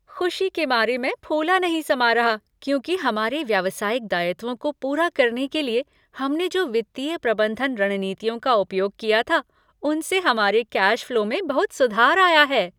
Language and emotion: Hindi, happy